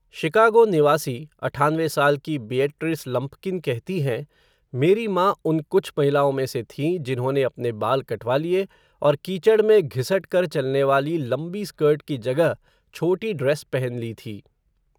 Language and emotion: Hindi, neutral